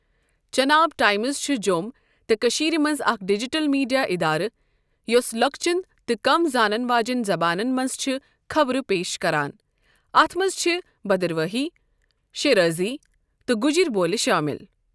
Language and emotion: Kashmiri, neutral